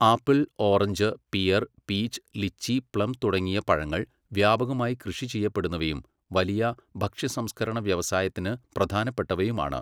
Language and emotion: Malayalam, neutral